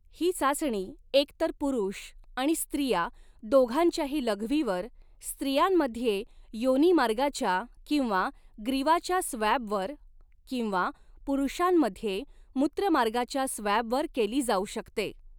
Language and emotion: Marathi, neutral